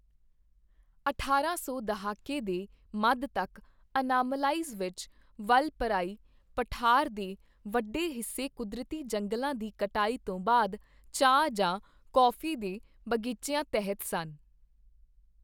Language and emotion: Punjabi, neutral